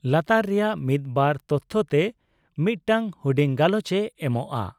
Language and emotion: Santali, neutral